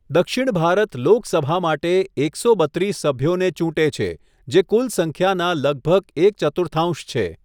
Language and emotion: Gujarati, neutral